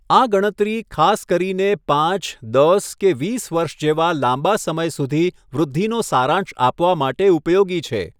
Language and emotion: Gujarati, neutral